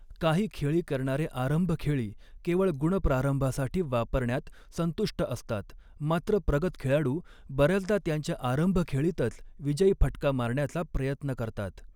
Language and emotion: Marathi, neutral